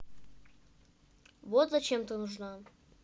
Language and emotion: Russian, neutral